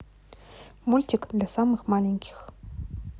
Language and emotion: Russian, neutral